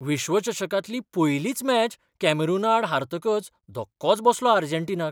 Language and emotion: Goan Konkani, surprised